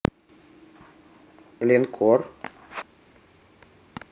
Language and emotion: Russian, neutral